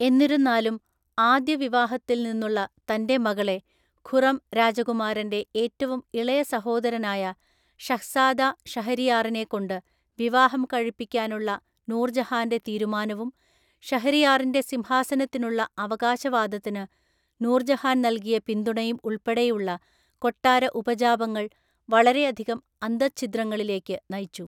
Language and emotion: Malayalam, neutral